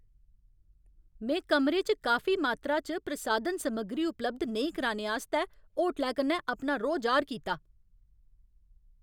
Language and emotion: Dogri, angry